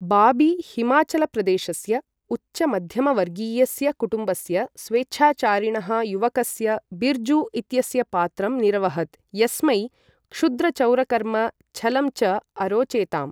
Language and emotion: Sanskrit, neutral